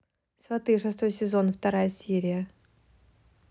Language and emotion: Russian, neutral